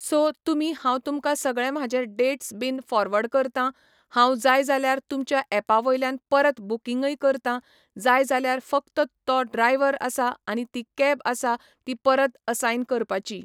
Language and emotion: Goan Konkani, neutral